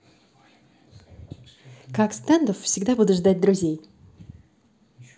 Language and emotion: Russian, positive